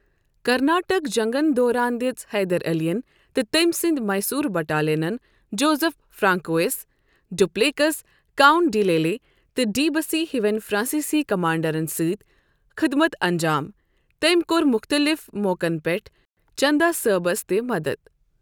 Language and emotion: Kashmiri, neutral